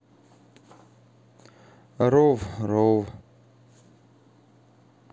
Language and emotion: Russian, sad